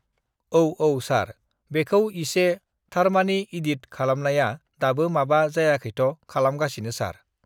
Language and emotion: Bodo, neutral